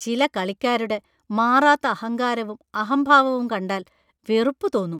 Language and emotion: Malayalam, disgusted